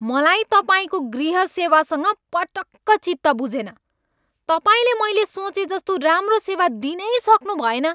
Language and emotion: Nepali, angry